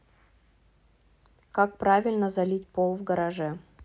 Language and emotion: Russian, neutral